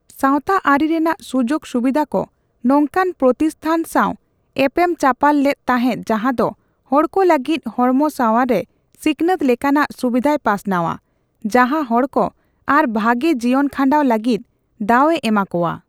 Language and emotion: Santali, neutral